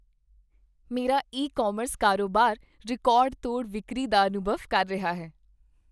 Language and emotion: Punjabi, happy